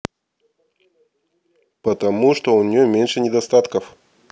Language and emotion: Russian, neutral